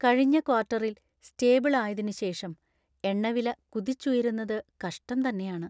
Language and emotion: Malayalam, sad